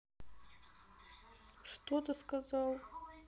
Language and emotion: Russian, neutral